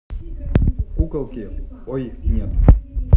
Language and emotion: Russian, neutral